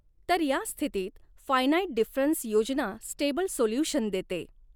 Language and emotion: Marathi, neutral